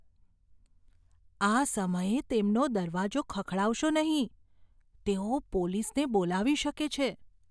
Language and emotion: Gujarati, fearful